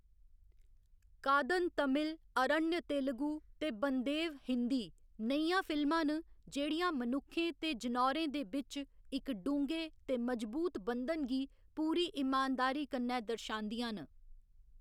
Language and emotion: Dogri, neutral